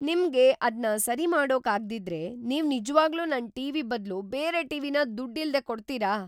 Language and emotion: Kannada, surprised